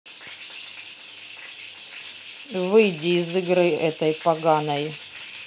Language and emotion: Russian, angry